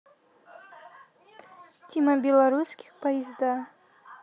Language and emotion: Russian, neutral